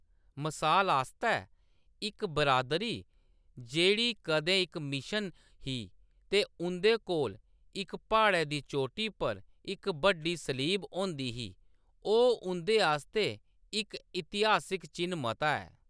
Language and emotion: Dogri, neutral